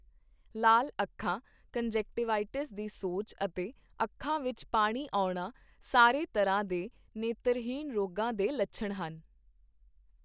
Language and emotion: Punjabi, neutral